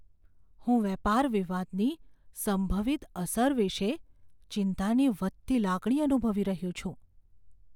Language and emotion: Gujarati, fearful